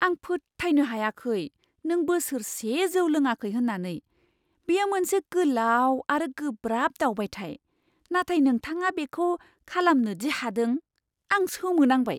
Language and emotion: Bodo, surprised